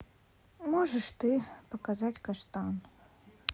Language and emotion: Russian, sad